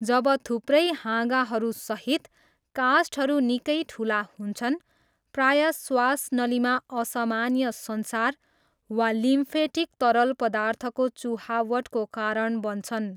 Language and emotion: Nepali, neutral